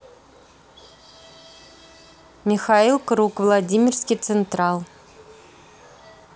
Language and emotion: Russian, neutral